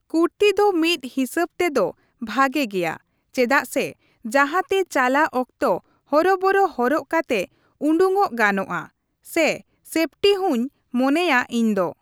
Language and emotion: Santali, neutral